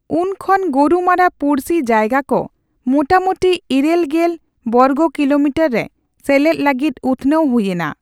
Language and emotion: Santali, neutral